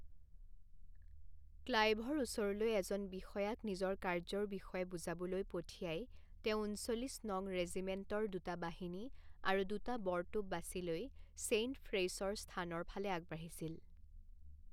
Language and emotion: Assamese, neutral